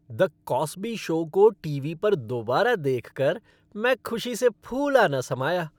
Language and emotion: Hindi, happy